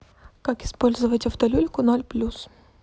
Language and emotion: Russian, neutral